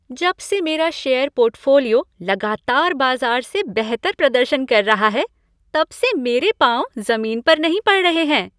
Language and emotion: Hindi, happy